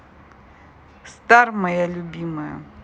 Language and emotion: Russian, neutral